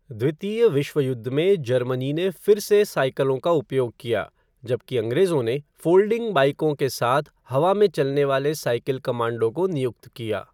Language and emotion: Hindi, neutral